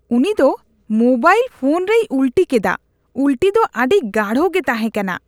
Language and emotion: Santali, disgusted